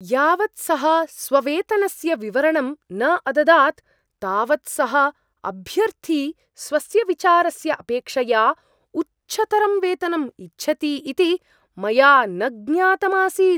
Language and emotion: Sanskrit, surprised